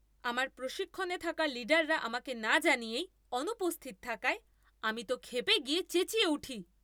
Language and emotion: Bengali, angry